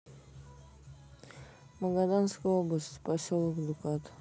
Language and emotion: Russian, neutral